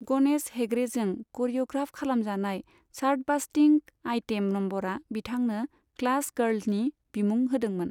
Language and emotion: Bodo, neutral